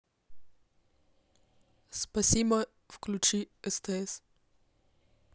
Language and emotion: Russian, neutral